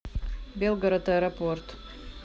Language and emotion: Russian, neutral